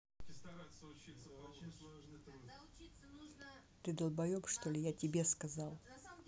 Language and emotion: Russian, angry